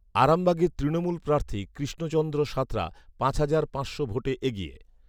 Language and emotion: Bengali, neutral